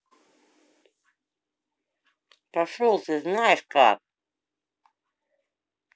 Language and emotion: Russian, angry